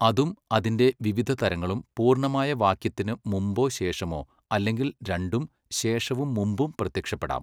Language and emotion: Malayalam, neutral